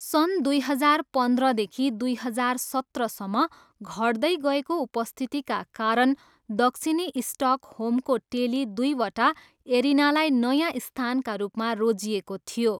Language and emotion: Nepali, neutral